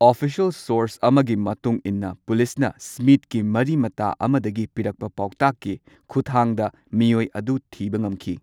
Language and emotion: Manipuri, neutral